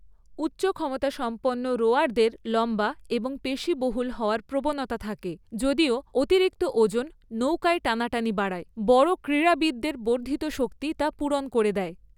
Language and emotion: Bengali, neutral